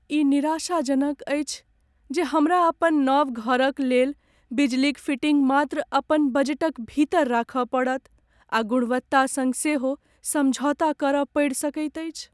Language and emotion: Maithili, sad